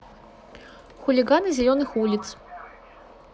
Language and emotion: Russian, neutral